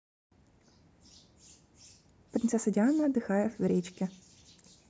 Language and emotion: Russian, neutral